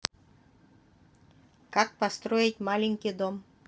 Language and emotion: Russian, neutral